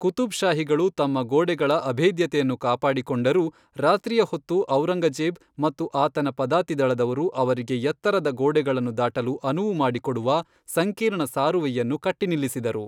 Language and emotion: Kannada, neutral